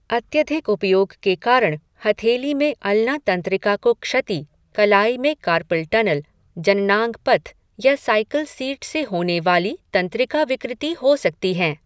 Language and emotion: Hindi, neutral